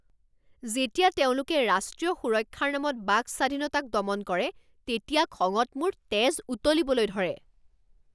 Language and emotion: Assamese, angry